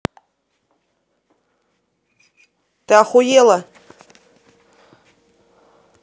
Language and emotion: Russian, angry